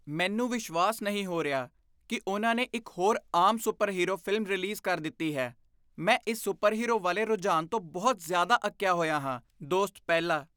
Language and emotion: Punjabi, disgusted